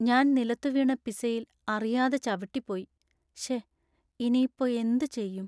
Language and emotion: Malayalam, sad